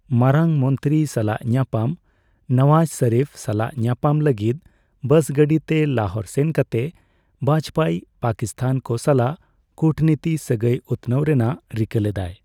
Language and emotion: Santali, neutral